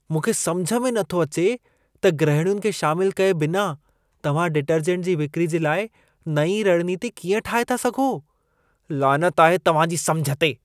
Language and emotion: Sindhi, disgusted